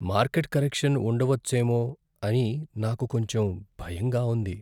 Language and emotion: Telugu, fearful